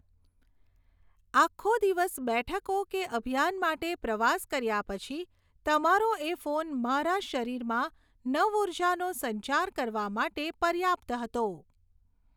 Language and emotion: Gujarati, neutral